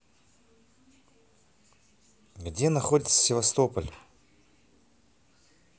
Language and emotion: Russian, neutral